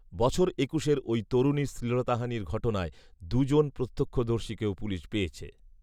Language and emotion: Bengali, neutral